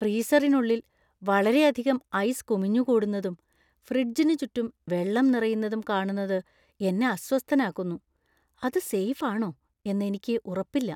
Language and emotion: Malayalam, fearful